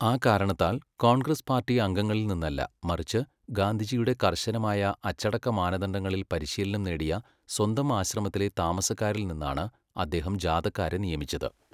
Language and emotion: Malayalam, neutral